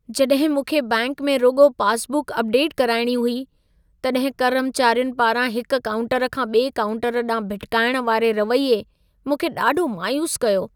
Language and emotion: Sindhi, sad